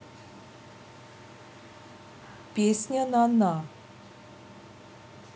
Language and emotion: Russian, neutral